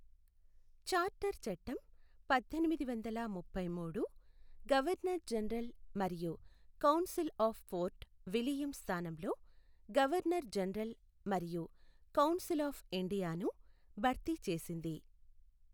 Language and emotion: Telugu, neutral